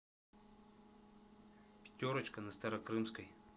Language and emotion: Russian, neutral